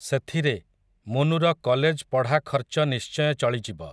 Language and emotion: Odia, neutral